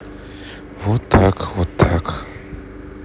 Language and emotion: Russian, sad